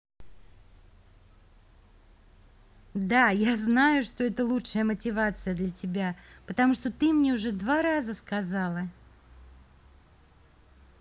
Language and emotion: Russian, positive